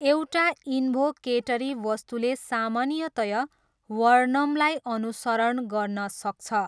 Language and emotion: Nepali, neutral